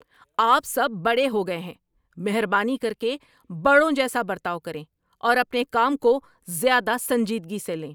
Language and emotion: Urdu, angry